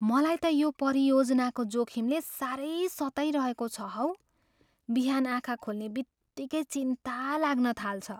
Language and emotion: Nepali, fearful